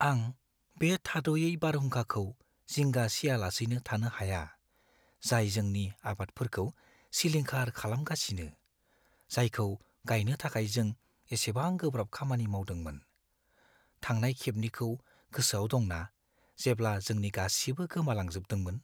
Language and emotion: Bodo, fearful